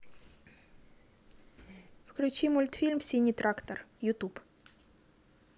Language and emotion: Russian, neutral